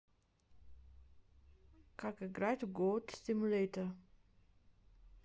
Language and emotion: Russian, neutral